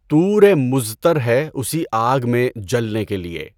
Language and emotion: Urdu, neutral